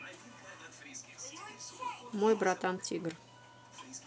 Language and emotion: Russian, neutral